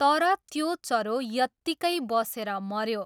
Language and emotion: Nepali, neutral